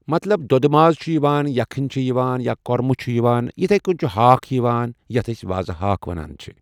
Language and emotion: Kashmiri, neutral